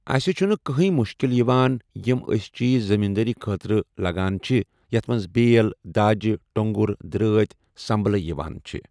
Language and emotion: Kashmiri, neutral